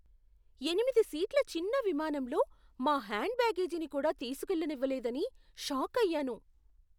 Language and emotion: Telugu, surprised